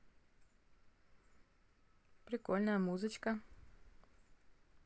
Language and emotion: Russian, positive